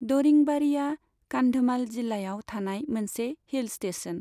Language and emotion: Bodo, neutral